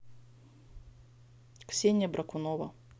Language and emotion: Russian, neutral